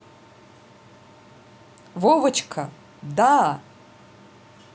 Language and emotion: Russian, neutral